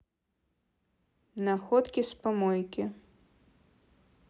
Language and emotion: Russian, neutral